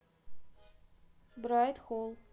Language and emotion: Russian, neutral